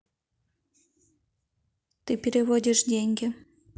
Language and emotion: Russian, neutral